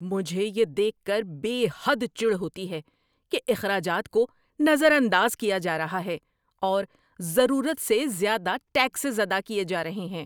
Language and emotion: Urdu, angry